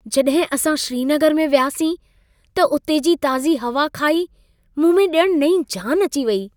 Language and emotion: Sindhi, happy